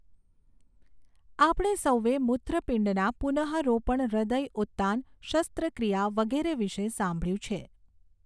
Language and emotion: Gujarati, neutral